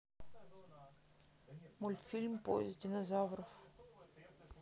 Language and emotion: Russian, sad